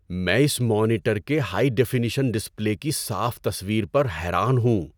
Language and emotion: Urdu, surprised